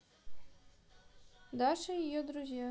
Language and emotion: Russian, neutral